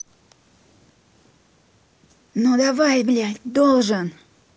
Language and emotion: Russian, angry